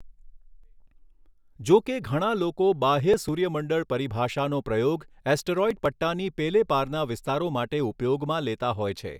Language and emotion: Gujarati, neutral